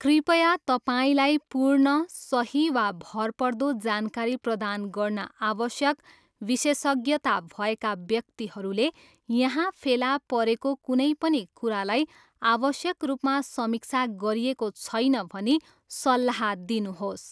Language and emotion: Nepali, neutral